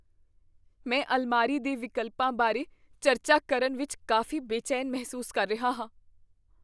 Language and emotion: Punjabi, fearful